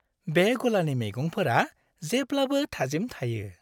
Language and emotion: Bodo, happy